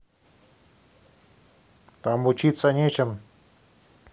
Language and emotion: Russian, neutral